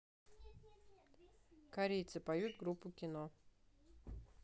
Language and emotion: Russian, neutral